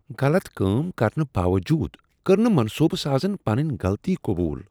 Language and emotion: Kashmiri, disgusted